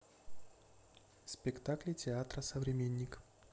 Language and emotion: Russian, neutral